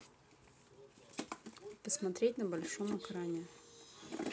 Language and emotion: Russian, neutral